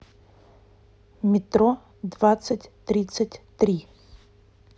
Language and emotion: Russian, neutral